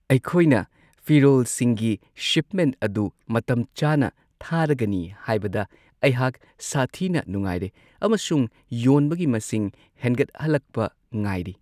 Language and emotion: Manipuri, happy